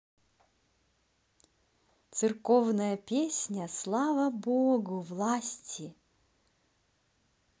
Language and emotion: Russian, positive